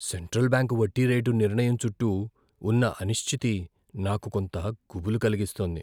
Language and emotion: Telugu, fearful